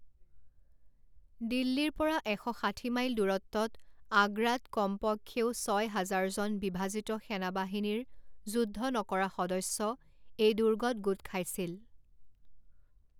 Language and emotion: Assamese, neutral